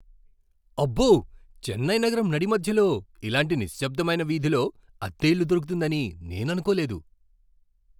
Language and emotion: Telugu, surprised